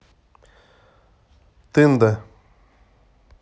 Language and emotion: Russian, neutral